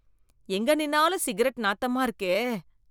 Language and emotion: Tamil, disgusted